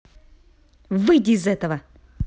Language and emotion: Russian, angry